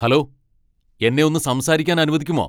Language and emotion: Malayalam, angry